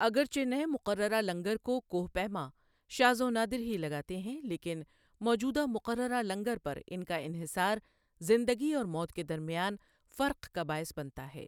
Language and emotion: Urdu, neutral